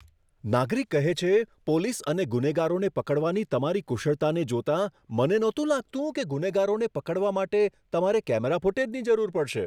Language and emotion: Gujarati, surprised